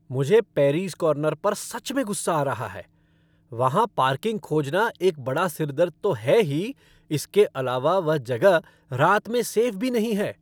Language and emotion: Hindi, angry